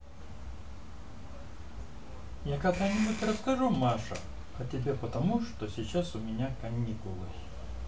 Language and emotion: Russian, neutral